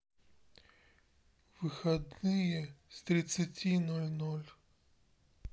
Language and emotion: Russian, sad